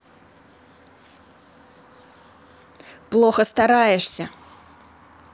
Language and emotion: Russian, angry